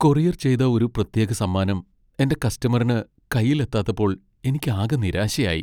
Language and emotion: Malayalam, sad